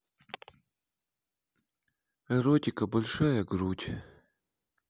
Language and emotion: Russian, sad